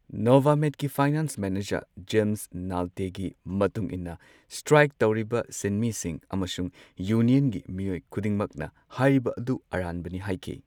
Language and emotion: Manipuri, neutral